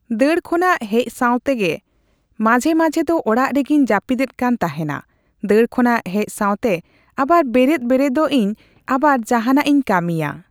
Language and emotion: Santali, neutral